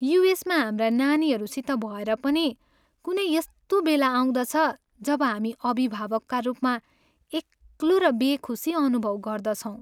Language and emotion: Nepali, sad